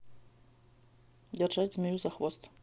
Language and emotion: Russian, neutral